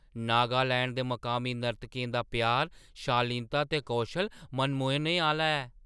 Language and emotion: Dogri, surprised